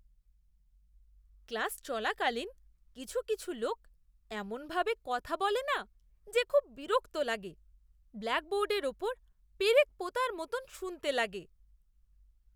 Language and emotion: Bengali, disgusted